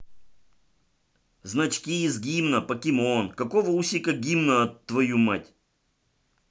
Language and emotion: Russian, angry